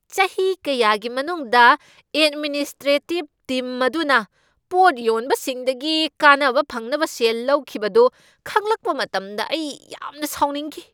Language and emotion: Manipuri, angry